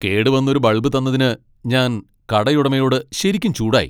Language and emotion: Malayalam, angry